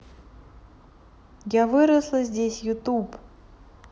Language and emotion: Russian, neutral